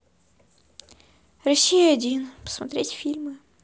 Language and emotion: Russian, sad